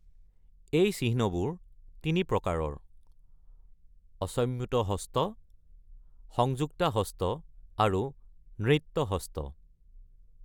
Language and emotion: Assamese, neutral